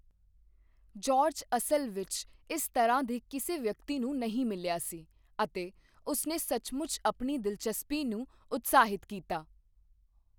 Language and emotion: Punjabi, neutral